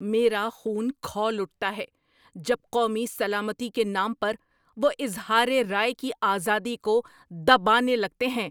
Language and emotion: Urdu, angry